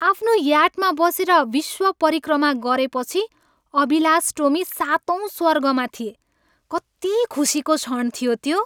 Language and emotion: Nepali, happy